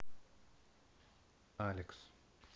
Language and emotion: Russian, neutral